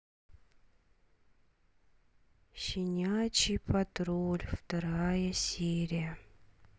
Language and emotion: Russian, sad